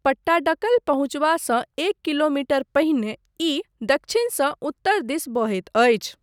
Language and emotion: Maithili, neutral